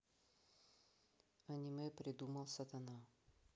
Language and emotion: Russian, neutral